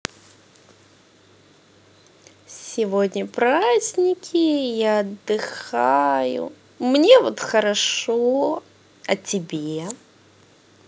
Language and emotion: Russian, positive